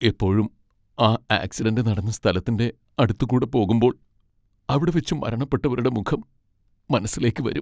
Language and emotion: Malayalam, sad